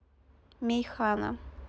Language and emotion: Russian, neutral